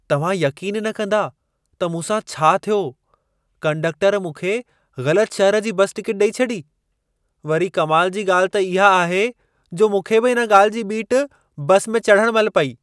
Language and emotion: Sindhi, surprised